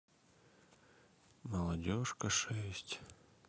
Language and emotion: Russian, sad